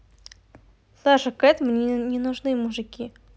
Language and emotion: Russian, neutral